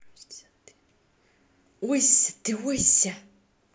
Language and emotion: Russian, positive